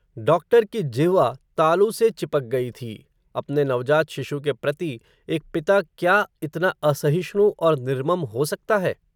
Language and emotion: Hindi, neutral